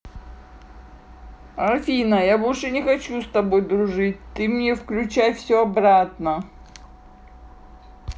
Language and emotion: Russian, sad